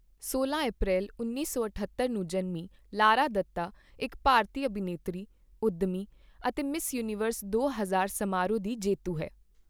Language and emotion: Punjabi, neutral